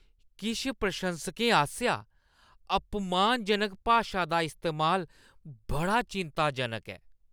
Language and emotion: Dogri, disgusted